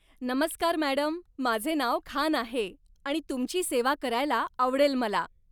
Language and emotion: Marathi, happy